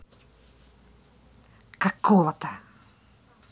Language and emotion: Russian, angry